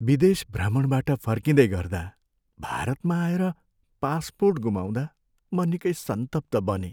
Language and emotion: Nepali, sad